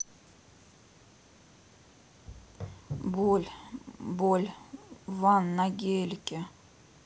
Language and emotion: Russian, sad